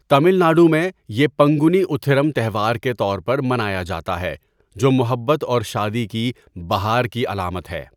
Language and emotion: Urdu, neutral